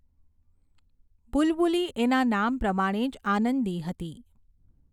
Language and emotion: Gujarati, neutral